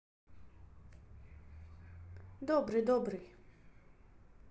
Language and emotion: Russian, neutral